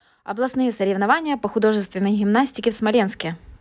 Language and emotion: Russian, neutral